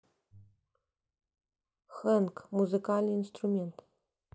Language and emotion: Russian, neutral